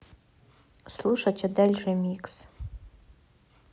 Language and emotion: Russian, neutral